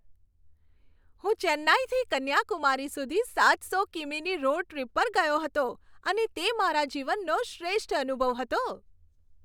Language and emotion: Gujarati, happy